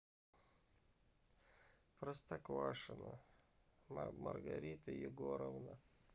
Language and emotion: Russian, sad